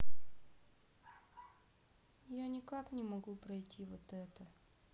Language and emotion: Russian, sad